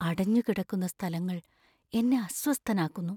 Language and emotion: Malayalam, fearful